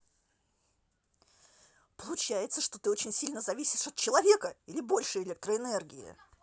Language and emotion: Russian, angry